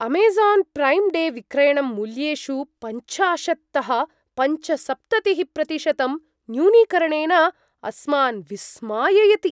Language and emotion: Sanskrit, surprised